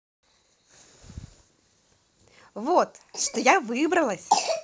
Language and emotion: Russian, positive